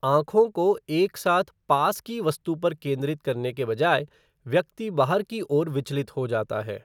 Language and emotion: Hindi, neutral